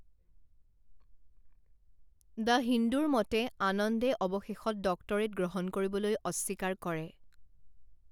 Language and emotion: Assamese, neutral